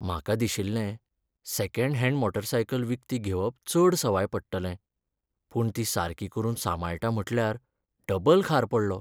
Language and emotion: Goan Konkani, sad